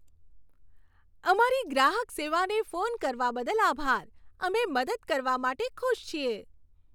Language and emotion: Gujarati, happy